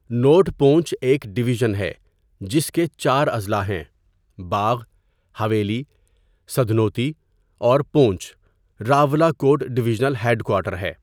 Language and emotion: Urdu, neutral